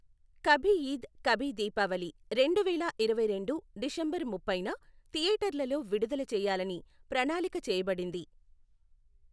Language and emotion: Telugu, neutral